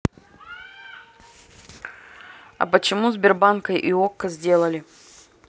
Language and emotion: Russian, neutral